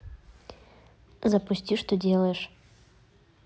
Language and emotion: Russian, neutral